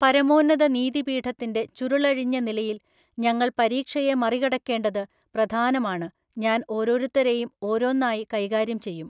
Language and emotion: Malayalam, neutral